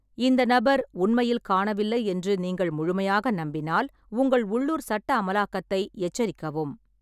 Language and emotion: Tamil, neutral